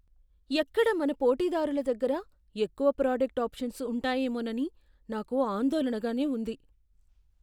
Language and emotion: Telugu, fearful